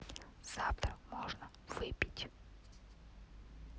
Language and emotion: Russian, neutral